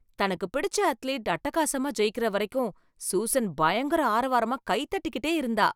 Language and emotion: Tamil, happy